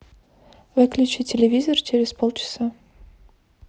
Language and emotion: Russian, neutral